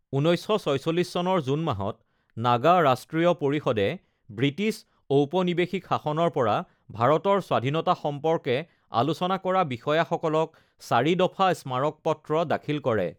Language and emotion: Assamese, neutral